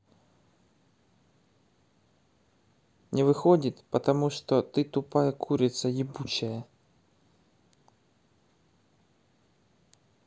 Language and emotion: Russian, neutral